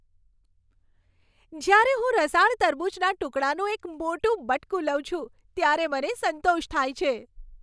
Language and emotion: Gujarati, happy